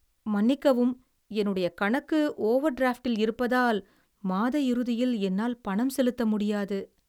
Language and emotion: Tamil, sad